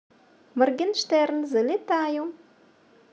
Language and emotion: Russian, positive